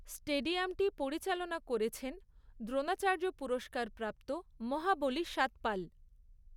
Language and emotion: Bengali, neutral